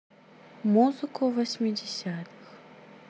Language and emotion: Russian, sad